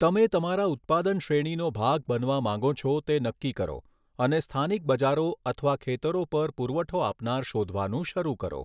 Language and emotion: Gujarati, neutral